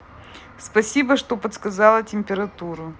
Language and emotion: Russian, positive